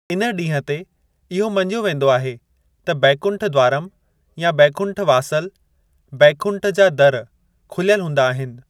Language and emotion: Sindhi, neutral